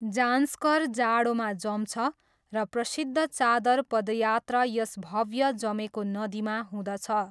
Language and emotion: Nepali, neutral